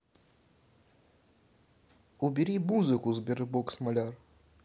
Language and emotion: Russian, neutral